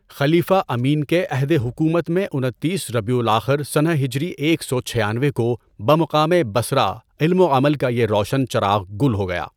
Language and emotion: Urdu, neutral